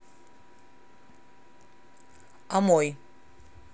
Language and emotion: Russian, neutral